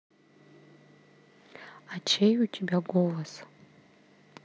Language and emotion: Russian, neutral